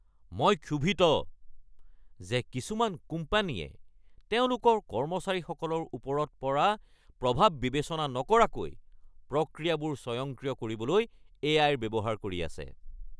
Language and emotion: Assamese, angry